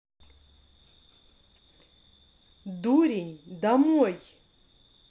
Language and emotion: Russian, angry